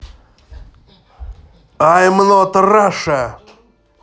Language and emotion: Russian, positive